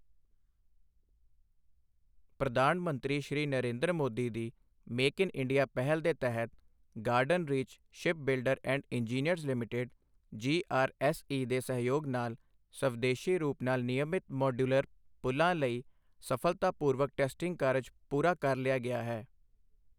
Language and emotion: Punjabi, neutral